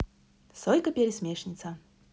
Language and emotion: Russian, positive